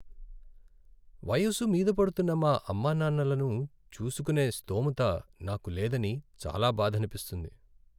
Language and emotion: Telugu, sad